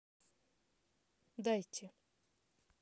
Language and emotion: Russian, neutral